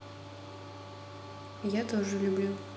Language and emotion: Russian, neutral